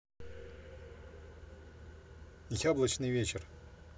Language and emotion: Russian, neutral